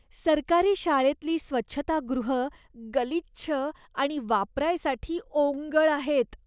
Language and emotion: Marathi, disgusted